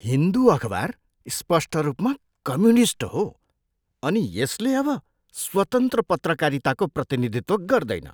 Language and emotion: Nepali, disgusted